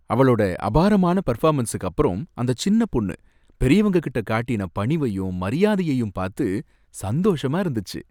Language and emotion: Tamil, happy